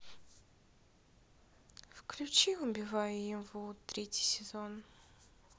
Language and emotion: Russian, sad